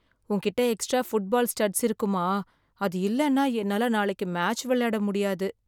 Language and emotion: Tamil, sad